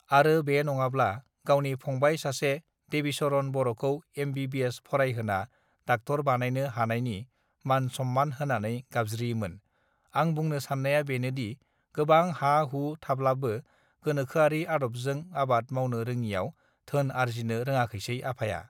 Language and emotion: Bodo, neutral